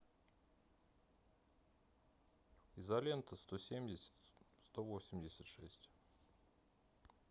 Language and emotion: Russian, neutral